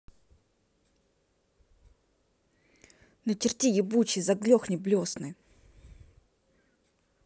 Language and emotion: Russian, angry